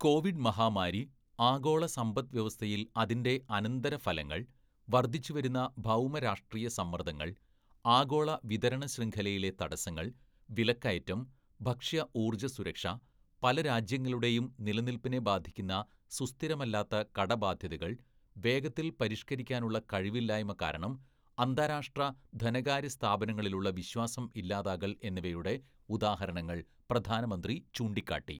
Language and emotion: Malayalam, neutral